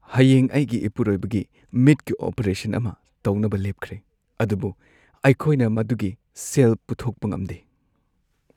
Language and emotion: Manipuri, sad